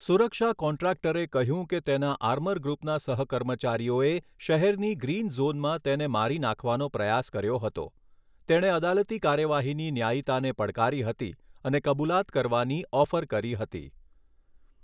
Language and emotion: Gujarati, neutral